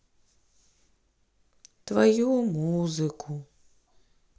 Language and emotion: Russian, sad